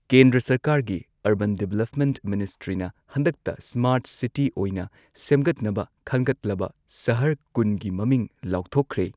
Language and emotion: Manipuri, neutral